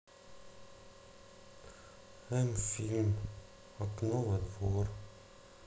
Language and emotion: Russian, sad